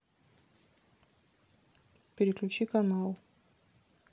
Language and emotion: Russian, neutral